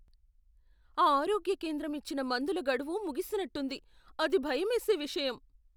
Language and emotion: Telugu, fearful